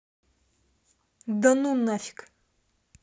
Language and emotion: Russian, angry